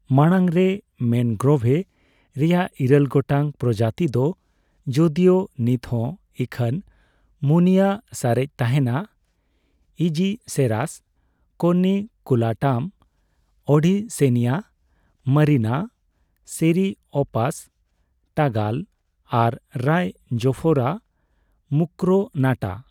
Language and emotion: Santali, neutral